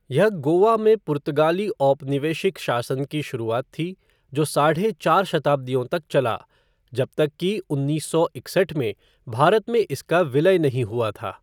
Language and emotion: Hindi, neutral